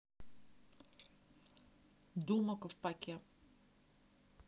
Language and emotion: Russian, neutral